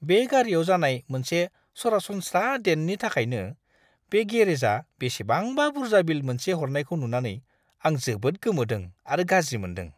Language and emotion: Bodo, disgusted